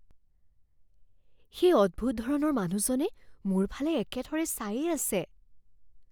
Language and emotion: Assamese, fearful